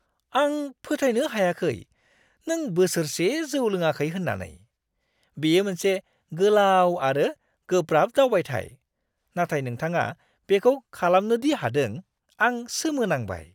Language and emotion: Bodo, surprised